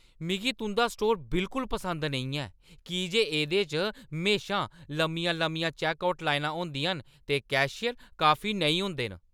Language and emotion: Dogri, angry